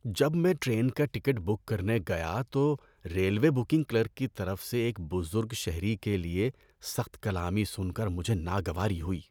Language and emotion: Urdu, disgusted